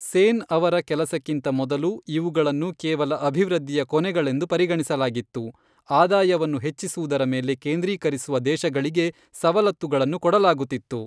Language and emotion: Kannada, neutral